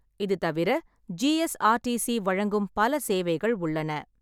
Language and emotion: Tamil, neutral